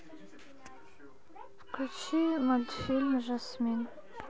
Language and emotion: Russian, neutral